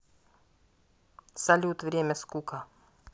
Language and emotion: Russian, neutral